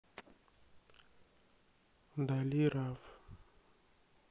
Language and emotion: Russian, sad